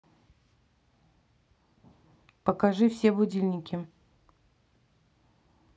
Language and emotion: Russian, neutral